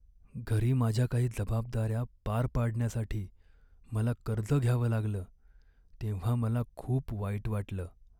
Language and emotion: Marathi, sad